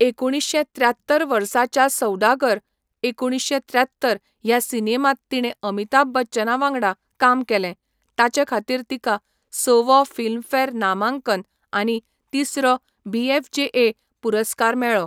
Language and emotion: Goan Konkani, neutral